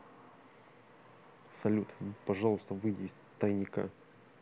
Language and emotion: Russian, neutral